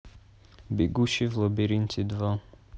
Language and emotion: Russian, neutral